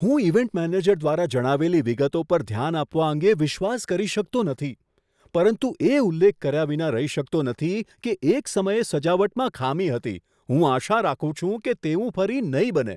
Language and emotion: Gujarati, surprised